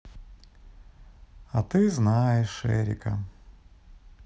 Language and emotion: Russian, sad